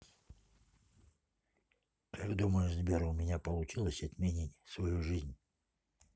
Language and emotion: Russian, neutral